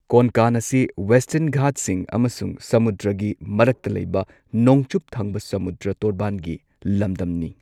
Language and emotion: Manipuri, neutral